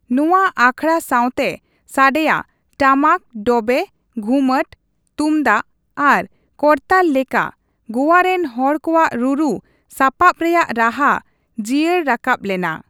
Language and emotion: Santali, neutral